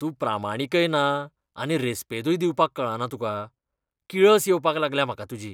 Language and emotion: Goan Konkani, disgusted